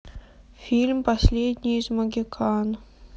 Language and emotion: Russian, sad